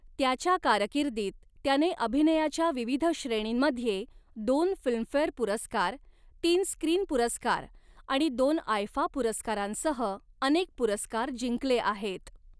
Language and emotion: Marathi, neutral